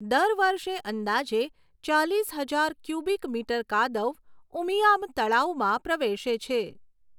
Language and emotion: Gujarati, neutral